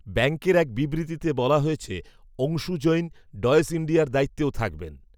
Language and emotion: Bengali, neutral